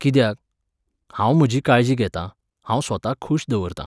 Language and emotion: Goan Konkani, neutral